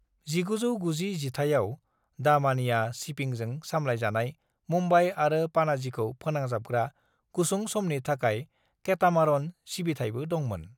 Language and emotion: Bodo, neutral